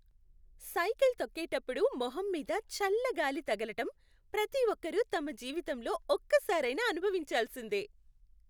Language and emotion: Telugu, happy